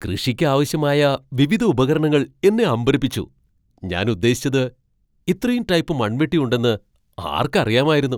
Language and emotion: Malayalam, surprised